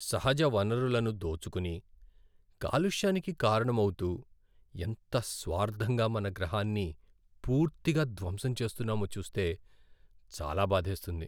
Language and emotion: Telugu, sad